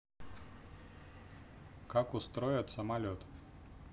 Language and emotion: Russian, neutral